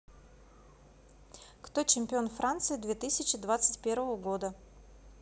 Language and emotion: Russian, neutral